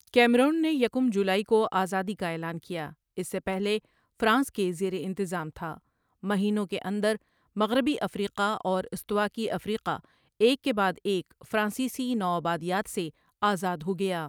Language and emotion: Urdu, neutral